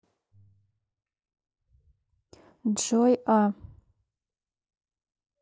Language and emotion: Russian, neutral